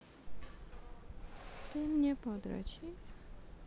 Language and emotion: Russian, neutral